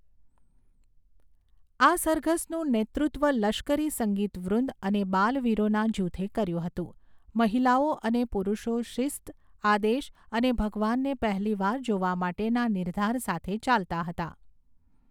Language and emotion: Gujarati, neutral